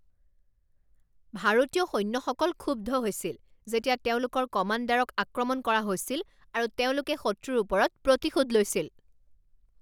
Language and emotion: Assamese, angry